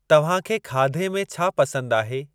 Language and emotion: Sindhi, neutral